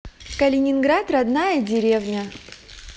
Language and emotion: Russian, positive